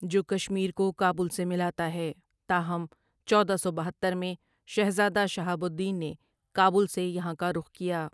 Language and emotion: Urdu, neutral